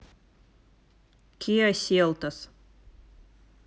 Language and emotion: Russian, neutral